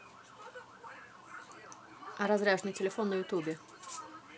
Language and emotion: Russian, neutral